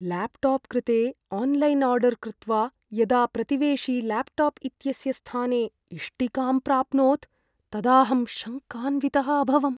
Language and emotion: Sanskrit, fearful